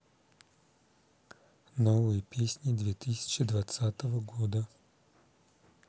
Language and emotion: Russian, neutral